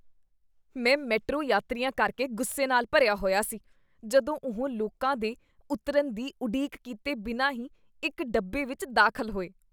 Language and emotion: Punjabi, disgusted